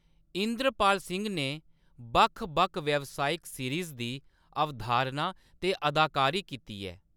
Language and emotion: Dogri, neutral